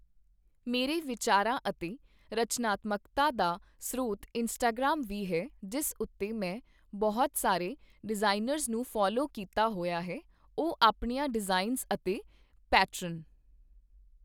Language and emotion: Punjabi, neutral